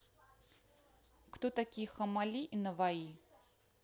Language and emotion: Russian, neutral